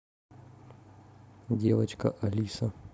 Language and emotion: Russian, neutral